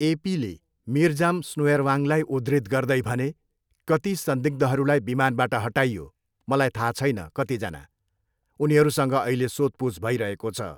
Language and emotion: Nepali, neutral